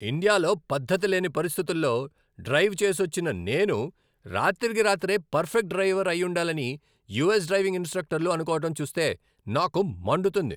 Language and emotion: Telugu, angry